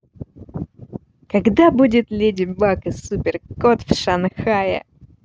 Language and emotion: Russian, positive